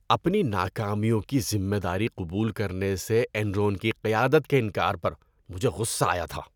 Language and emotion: Urdu, disgusted